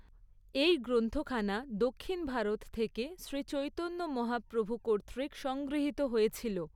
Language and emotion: Bengali, neutral